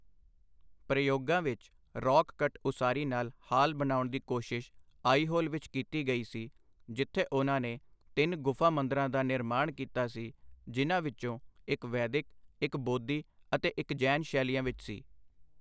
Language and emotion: Punjabi, neutral